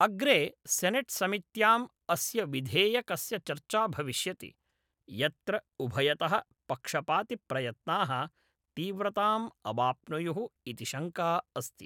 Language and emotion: Sanskrit, neutral